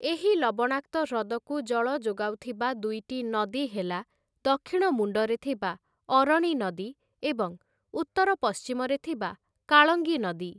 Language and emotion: Odia, neutral